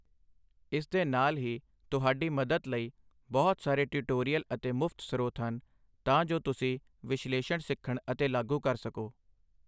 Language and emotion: Punjabi, neutral